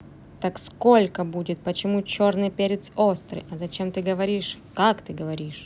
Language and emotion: Russian, angry